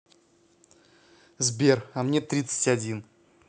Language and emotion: Russian, neutral